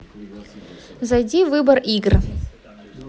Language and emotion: Russian, neutral